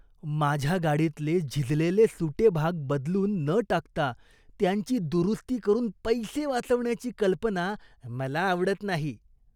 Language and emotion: Marathi, disgusted